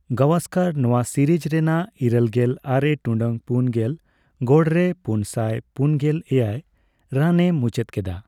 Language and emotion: Santali, neutral